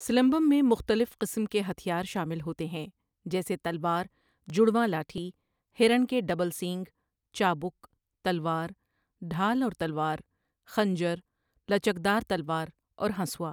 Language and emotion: Urdu, neutral